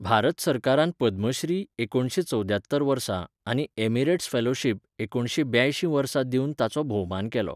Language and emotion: Goan Konkani, neutral